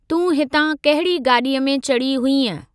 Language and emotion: Sindhi, neutral